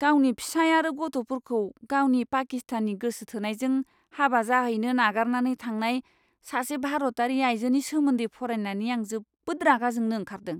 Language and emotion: Bodo, disgusted